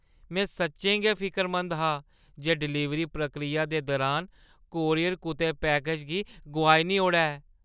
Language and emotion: Dogri, fearful